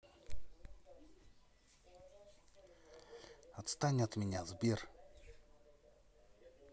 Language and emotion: Russian, angry